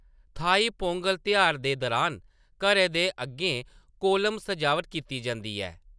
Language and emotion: Dogri, neutral